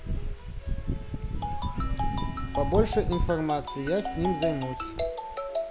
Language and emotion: Russian, neutral